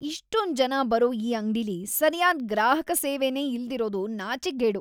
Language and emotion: Kannada, disgusted